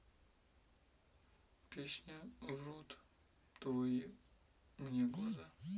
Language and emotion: Russian, neutral